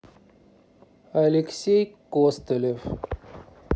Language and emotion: Russian, neutral